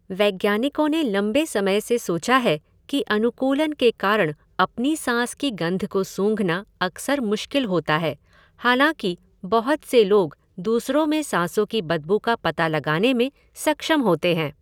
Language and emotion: Hindi, neutral